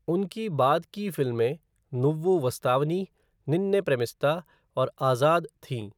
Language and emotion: Hindi, neutral